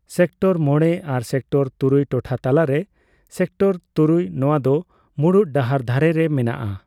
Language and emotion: Santali, neutral